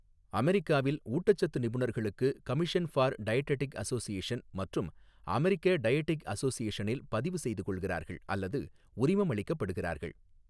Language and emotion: Tamil, neutral